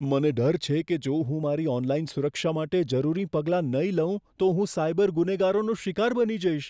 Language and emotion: Gujarati, fearful